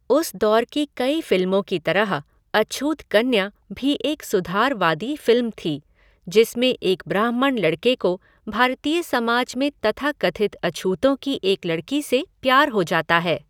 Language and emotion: Hindi, neutral